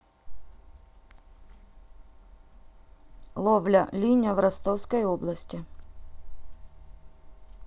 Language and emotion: Russian, neutral